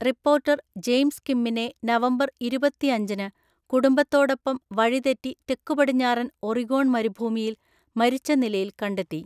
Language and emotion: Malayalam, neutral